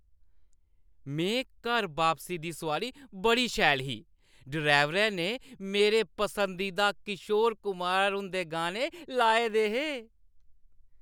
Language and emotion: Dogri, happy